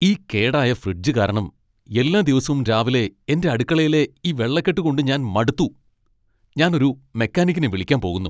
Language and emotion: Malayalam, angry